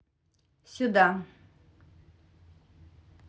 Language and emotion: Russian, neutral